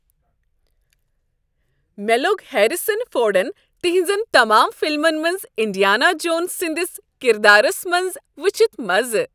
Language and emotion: Kashmiri, happy